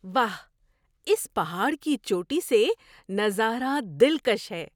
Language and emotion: Urdu, surprised